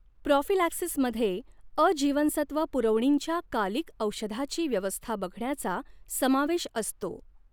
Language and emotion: Marathi, neutral